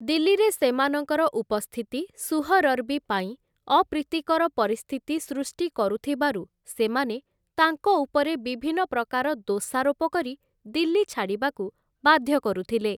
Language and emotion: Odia, neutral